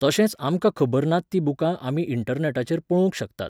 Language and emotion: Goan Konkani, neutral